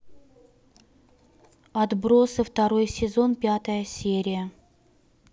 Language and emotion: Russian, neutral